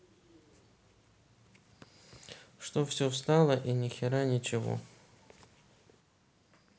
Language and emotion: Russian, sad